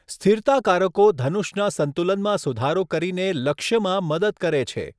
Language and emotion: Gujarati, neutral